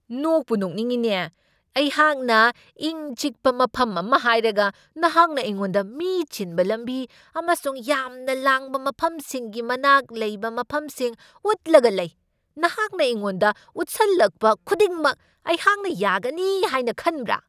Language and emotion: Manipuri, angry